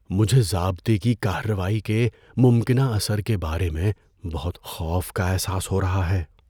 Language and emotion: Urdu, fearful